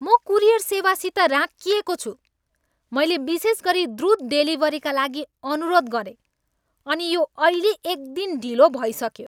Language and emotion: Nepali, angry